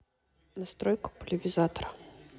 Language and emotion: Russian, neutral